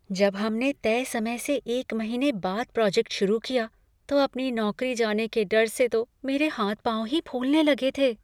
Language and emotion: Hindi, fearful